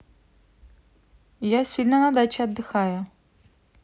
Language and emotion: Russian, neutral